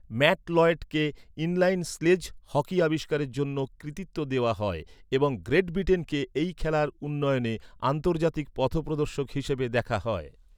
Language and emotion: Bengali, neutral